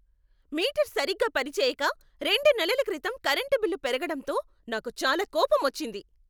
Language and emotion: Telugu, angry